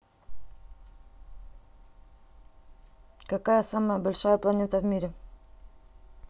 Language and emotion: Russian, neutral